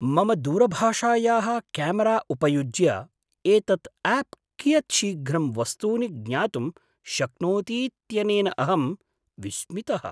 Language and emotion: Sanskrit, surprised